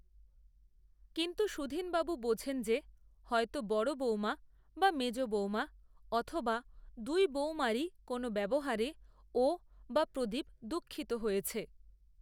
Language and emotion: Bengali, neutral